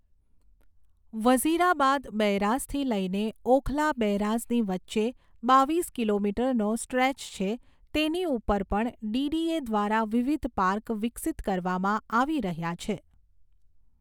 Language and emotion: Gujarati, neutral